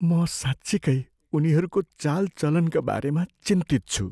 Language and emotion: Nepali, fearful